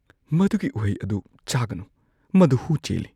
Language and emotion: Manipuri, fearful